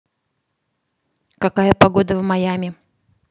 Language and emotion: Russian, neutral